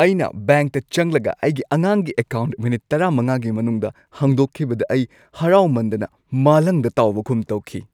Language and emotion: Manipuri, happy